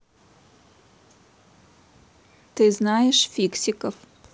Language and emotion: Russian, neutral